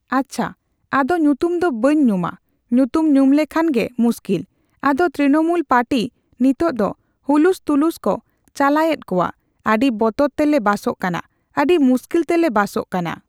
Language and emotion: Santali, neutral